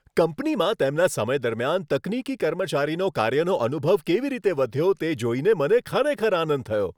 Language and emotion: Gujarati, happy